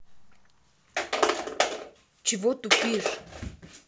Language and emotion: Russian, angry